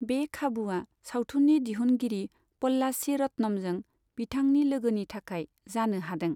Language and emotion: Bodo, neutral